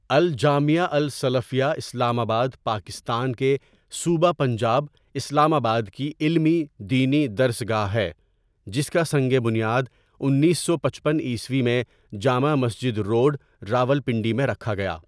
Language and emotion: Urdu, neutral